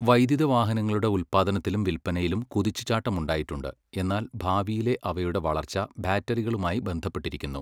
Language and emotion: Malayalam, neutral